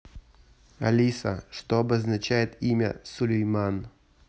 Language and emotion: Russian, neutral